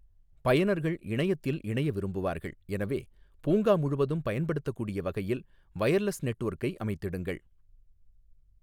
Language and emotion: Tamil, neutral